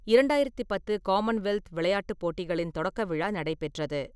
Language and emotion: Tamil, neutral